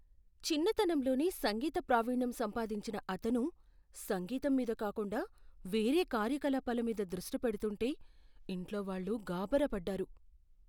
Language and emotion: Telugu, fearful